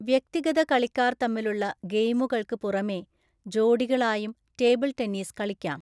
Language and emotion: Malayalam, neutral